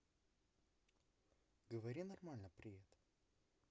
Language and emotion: Russian, neutral